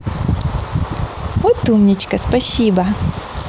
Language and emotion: Russian, positive